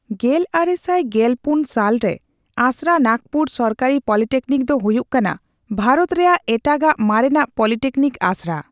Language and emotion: Santali, neutral